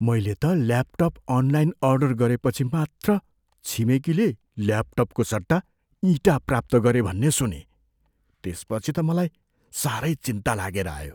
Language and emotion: Nepali, fearful